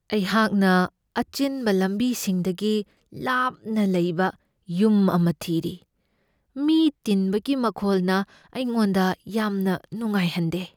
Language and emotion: Manipuri, fearful